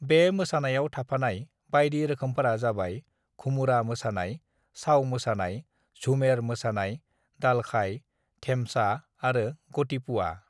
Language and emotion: Bodo, neutral